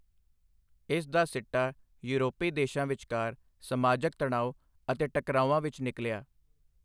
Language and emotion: Punjabi, neutral